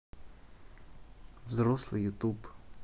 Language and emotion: Russian, neutral